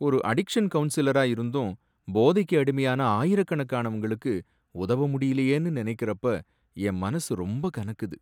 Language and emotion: Tamil, sad